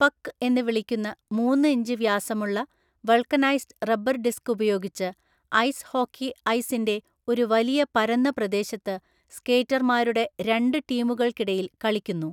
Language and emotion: Malayalam, neutral